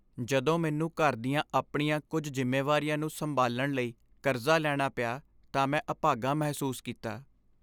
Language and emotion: Punjabi, sad